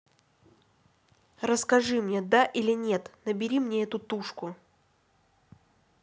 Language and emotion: Russian, angry